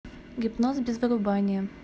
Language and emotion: Russian, neutral